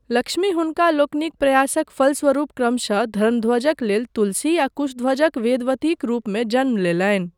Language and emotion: Maithili, neutral